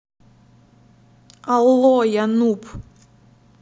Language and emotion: Russian, neutral